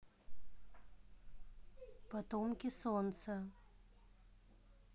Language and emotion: Russian, neutral